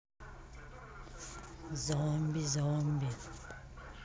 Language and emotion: Russian, neutral